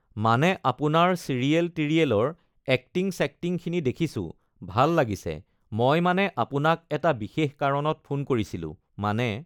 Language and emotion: Assamese, neutral